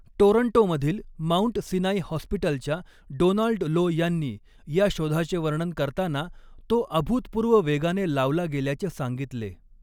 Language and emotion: Marathi, neutral